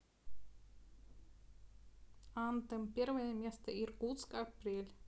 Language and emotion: Russian, neutral